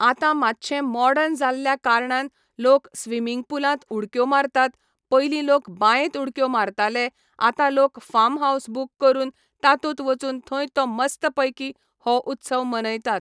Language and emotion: Goan Konkani, neutral